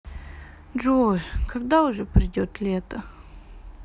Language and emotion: Russian, sad